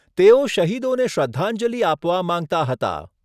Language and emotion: Gujarati, neutral